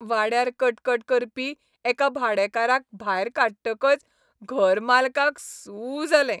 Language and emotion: Goan Konkani, happy